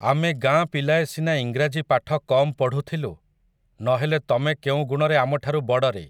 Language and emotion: Odia, neutral